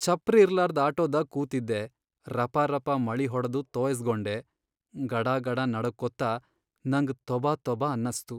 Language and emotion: Kannada, sad